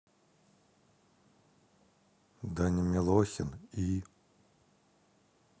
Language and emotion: Russian, neutral